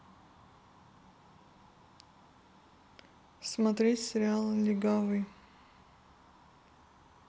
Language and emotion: Russian, neutral